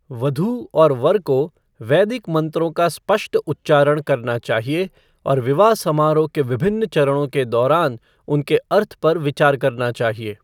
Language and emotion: Hindi, neutral